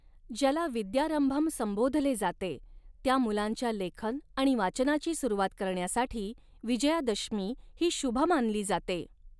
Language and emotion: Marathi, neutral